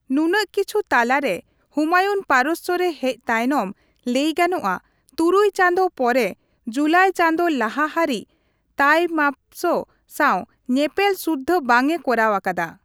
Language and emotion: Santali, neutral